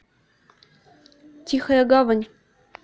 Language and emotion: Russian, neutral